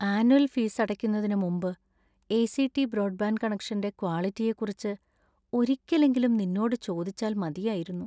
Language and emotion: Malayalam, sad